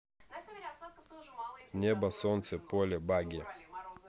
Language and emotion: Russian, neutral